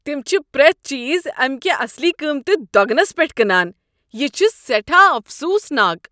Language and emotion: Kashmiri, disgusted